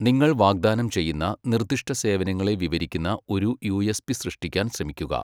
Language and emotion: Malayalam, neutral